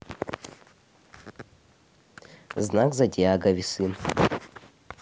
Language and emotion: Russian, neutral